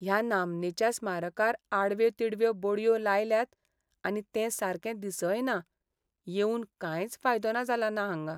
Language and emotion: Goan Konkani, sad